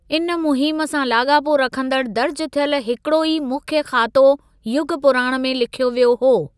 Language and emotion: Sindhi, neutral